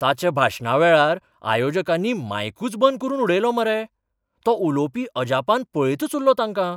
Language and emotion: Goan Konkani, surprised